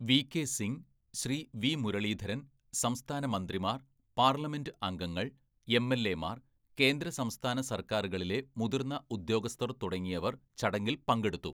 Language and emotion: Malayalam, neutral